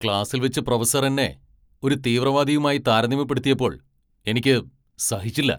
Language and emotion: Malayalam, angry